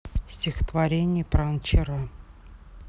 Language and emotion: Russian, neutral